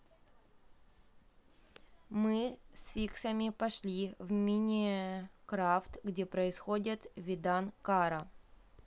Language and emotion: Russian, neutral